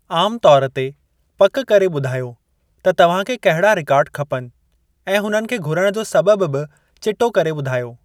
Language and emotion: Sindhi, neutral